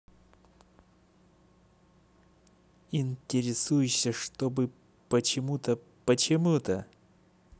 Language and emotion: Russian, neutral